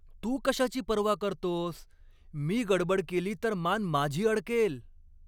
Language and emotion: Marathi, angry